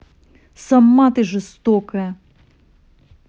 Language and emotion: Russian, angry